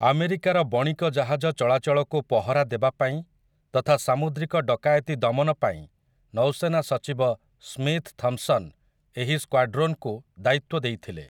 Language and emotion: Odia, neutral